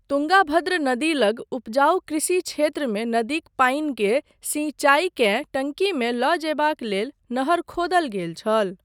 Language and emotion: Maithili, neutral